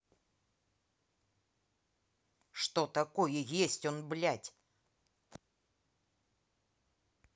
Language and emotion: Russian, angry